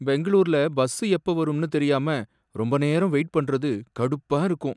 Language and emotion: Tamil, sad